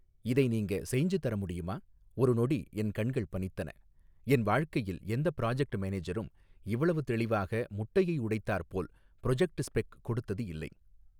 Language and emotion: Tamil, neutral